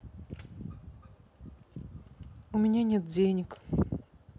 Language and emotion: Russian, sad